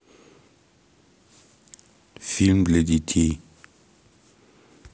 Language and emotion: Russian, neutral